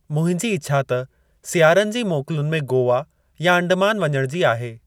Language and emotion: Sindhi, neutral